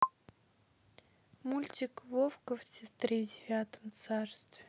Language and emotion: Russian, neutral